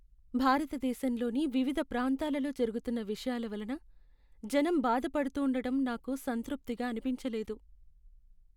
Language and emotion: Telugu, sad